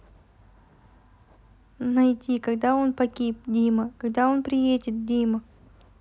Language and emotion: Russian, neutral